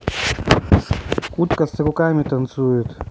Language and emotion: Russian, neutral